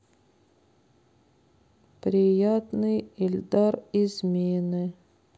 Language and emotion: Russian, sad